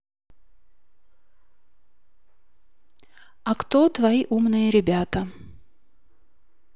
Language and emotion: Russian, neutral